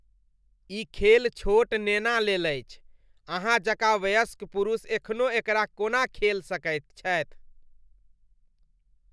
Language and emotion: Maithili, disgusted